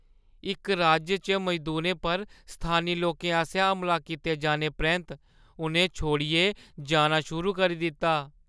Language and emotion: Dogri, fearful